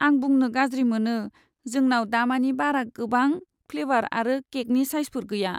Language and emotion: Bodo, sad